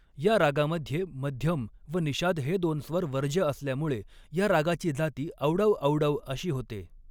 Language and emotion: Marathi, neutral